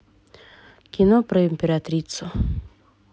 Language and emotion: Russian, neutral